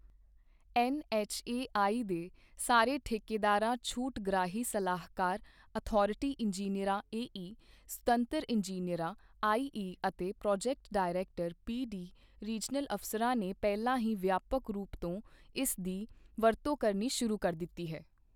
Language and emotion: Punjabi, neutral